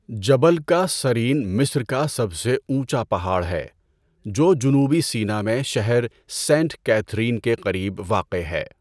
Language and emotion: Urdu, neutral